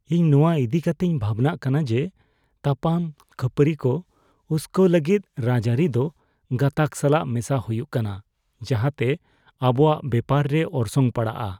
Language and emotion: Santali, fearful